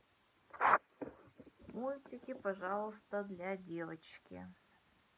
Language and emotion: Russian, neutral